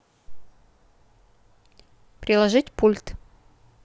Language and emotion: Russian, neutral